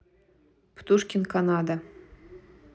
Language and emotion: Russian, neutral